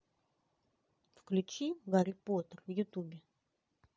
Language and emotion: Russian, neutral